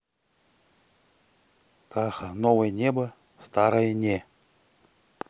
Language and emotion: Russian, neutral